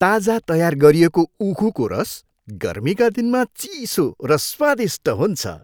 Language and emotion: Nepali, happy